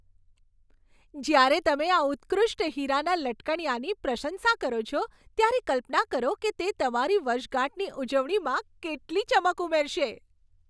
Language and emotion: Gujarati, happy